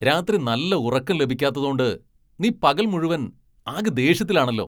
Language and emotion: Malayalam, angry